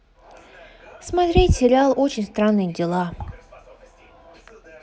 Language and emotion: Russian, neutral